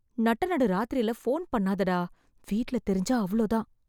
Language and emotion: Tamil, fearful